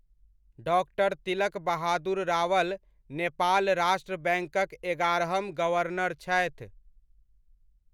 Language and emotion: Maithili, neutral